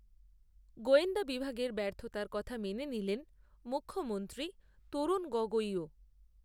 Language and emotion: Bengali, neutral